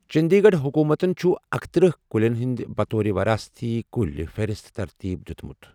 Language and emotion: Kashmiri, neutral